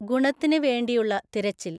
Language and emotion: Malayalam, neutral